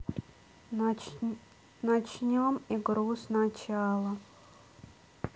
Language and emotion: Russian, sad